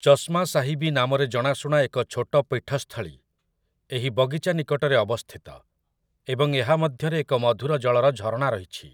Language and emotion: Odia, neutral